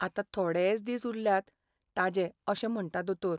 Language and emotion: Goan Konkani, sad